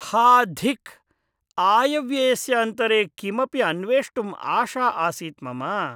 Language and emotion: Sanskrit, disgusted